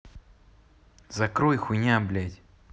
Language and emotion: Russian, angry